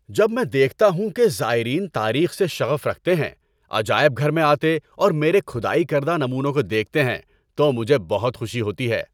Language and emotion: Urdu, happy